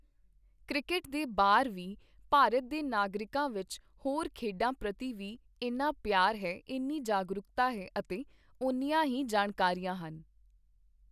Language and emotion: Punjabi, neutral